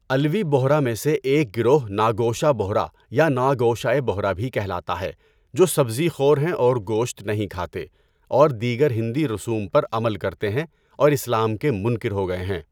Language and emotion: Urdu, neutral